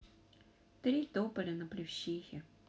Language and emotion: Russian, sad